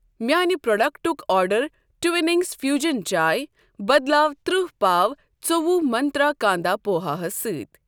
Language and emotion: Kashmiri, neutral